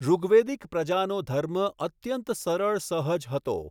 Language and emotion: Gujarati, neutral